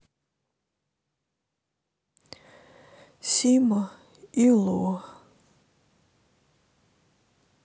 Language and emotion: Russian, sad